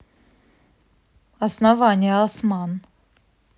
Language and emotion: Russian, neutral